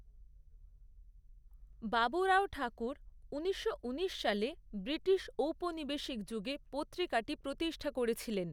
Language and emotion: Bengali, neutral